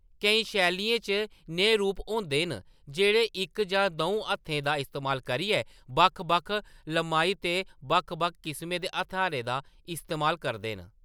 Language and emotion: Dogri, neutral